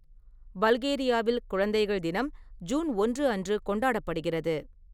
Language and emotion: Tamil, neutral